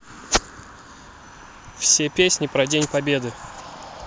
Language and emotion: Russian, neutral